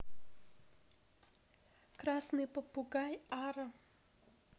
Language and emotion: Russian, neutral